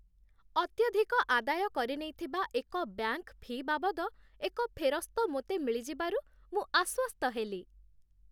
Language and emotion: Odia, happy